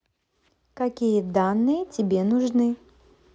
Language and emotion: Russian, positive